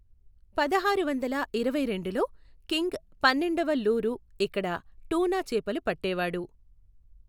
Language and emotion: Telugu, neutral